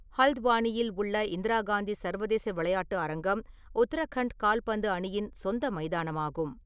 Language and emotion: Tamil, neutral